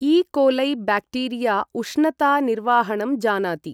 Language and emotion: Sanskrit, neutral